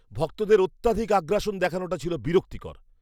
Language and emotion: Bengali, disgusted